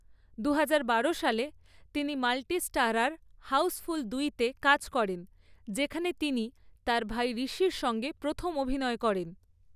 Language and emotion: Bengali, neutral